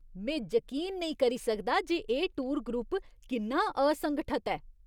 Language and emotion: Dogri, disgusted